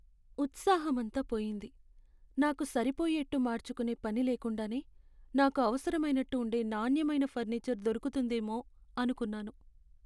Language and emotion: Telugu, sad